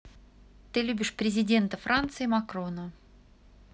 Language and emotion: Russian, neutral